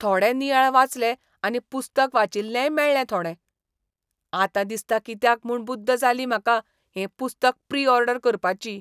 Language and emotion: Goan Konkani, disgusted